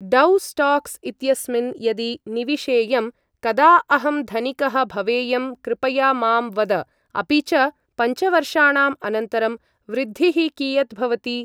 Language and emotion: Sanskrit, neutral